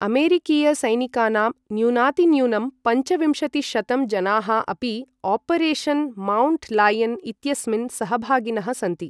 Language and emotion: Sanskrit, neutral